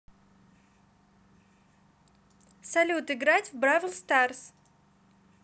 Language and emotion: Russian, positive